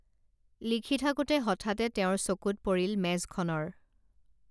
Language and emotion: Assamese, neutral